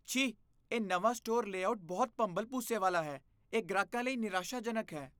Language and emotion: Punjabi, disgusted